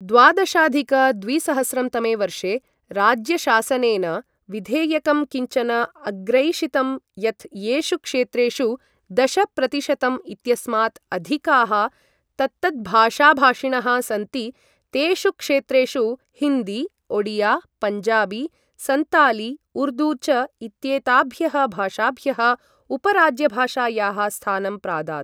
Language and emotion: Sanskrit, neutral